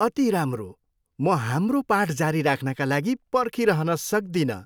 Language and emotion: Nepali, happy